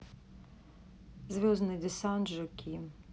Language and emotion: Russian, neutral